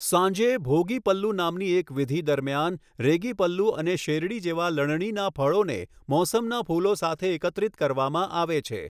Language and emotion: Gujarati, neutral